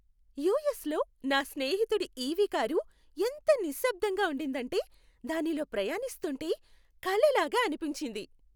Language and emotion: Telugu, happy